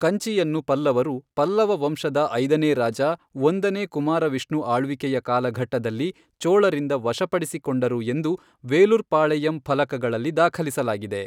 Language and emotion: Kannada, neutral